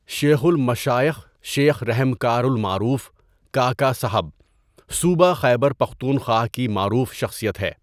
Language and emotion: Urdu, neutral